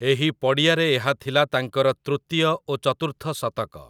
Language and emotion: Odia, neutral